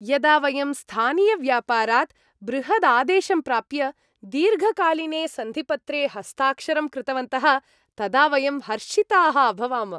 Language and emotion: Sanskrit, happy